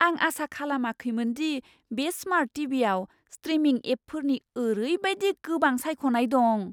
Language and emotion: Bodo, surprised